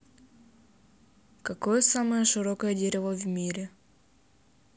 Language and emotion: Russian, neutral